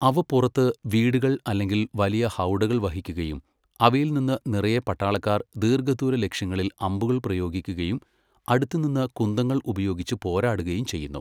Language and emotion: Malayalam, neutral